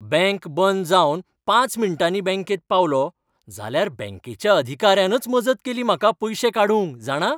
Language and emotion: Goan Konkani, happy